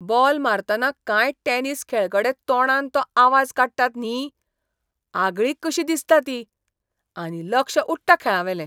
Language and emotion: Goan Konkani, disgusted